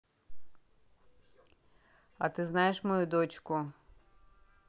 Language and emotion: Russian, neutral